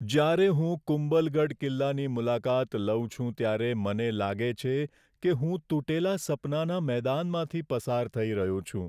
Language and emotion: Gujarati, sad